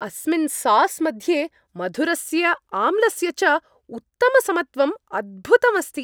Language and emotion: Sanskrit, happy